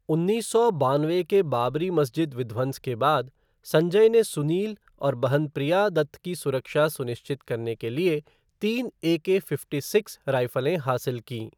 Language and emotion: Hindi, neutral